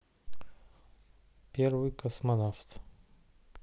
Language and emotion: Russian, neutral